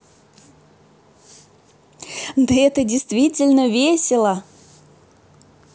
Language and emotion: Russian, positive